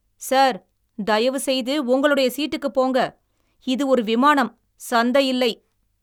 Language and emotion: Tamil, angry